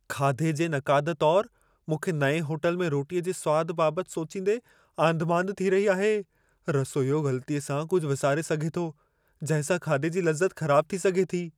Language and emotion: Sindhi, fearful